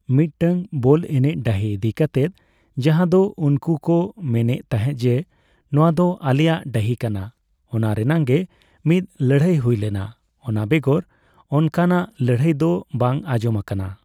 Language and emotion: Santali, neutral